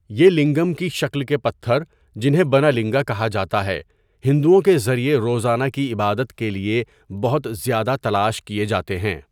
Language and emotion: Urdu, neutral